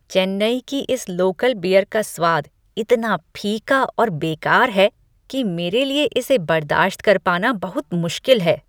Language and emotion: Hindi, disgusted